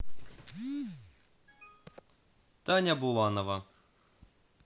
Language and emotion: Russian, neutral